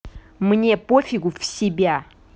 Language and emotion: Russian, angry